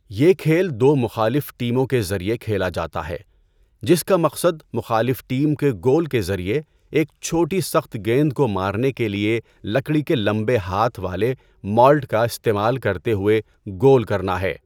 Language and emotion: Urdu, neutral